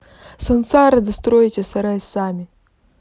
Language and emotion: Russian, neutral